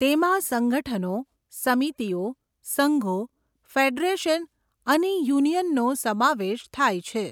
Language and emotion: Gujarati, neutral